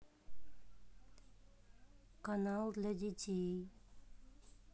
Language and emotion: Russian, neutral